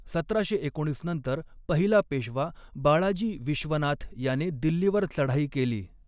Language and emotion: Marathi, neutral